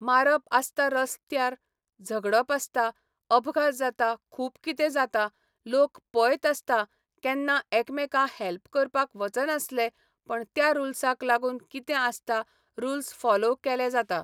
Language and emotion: Goan Konkani, neutral